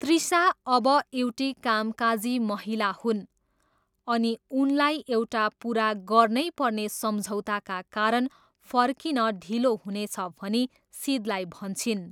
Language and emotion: Nepali, neutral